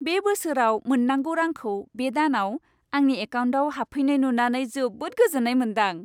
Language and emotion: Bodo, happy